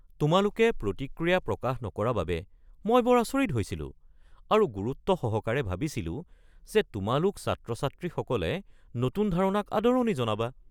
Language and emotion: Assamese, surprised